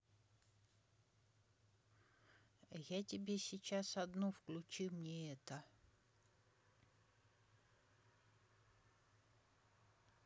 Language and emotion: Russian, neutral